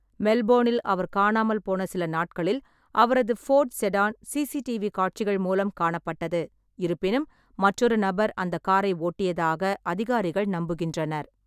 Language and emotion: Tamil, neutral